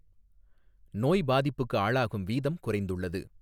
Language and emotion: Tamil, neutral